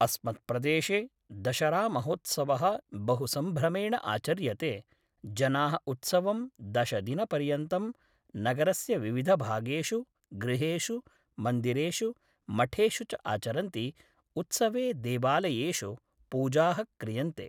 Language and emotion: Sanskrit, neutral